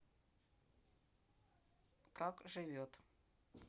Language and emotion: Russian, neutral